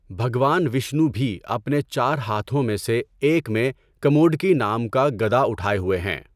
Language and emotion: Urdu, neutral